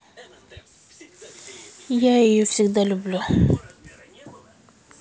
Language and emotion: Russian, sad